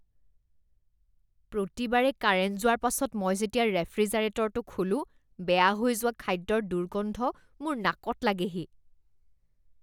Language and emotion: Assamese, disgusted